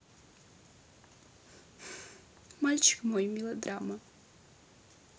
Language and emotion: Russian, sad